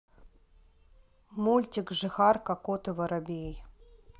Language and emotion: Russian, neutral